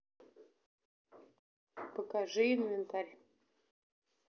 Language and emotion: Russian, neutral